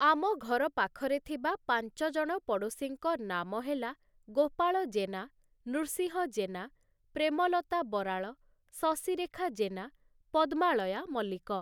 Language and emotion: Odia, neutral